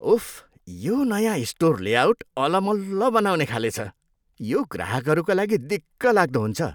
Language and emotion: Nepali, disgusted